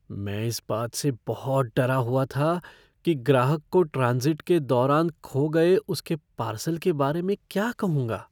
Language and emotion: Hindi, fearful